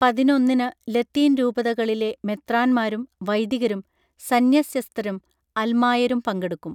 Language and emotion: Malayalam, neutral